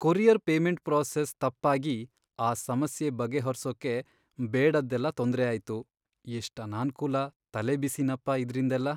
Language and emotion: Kannada, sad